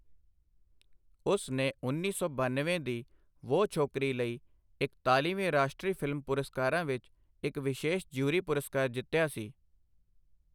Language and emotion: Punjabi, neutral